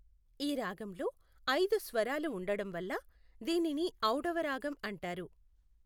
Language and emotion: Telugu, neutral